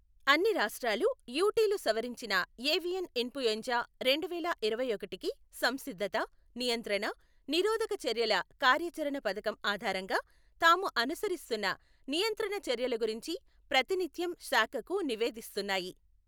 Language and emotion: Telugu, neutral